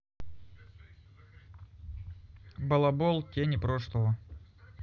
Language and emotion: Russian, neutral